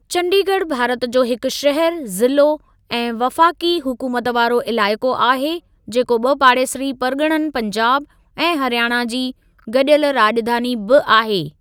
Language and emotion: Sindhi, neutral